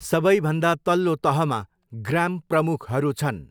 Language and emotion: Nepali, neutral